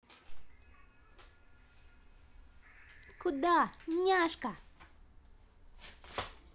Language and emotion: Russian, positive